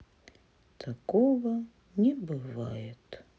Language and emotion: Russian, sad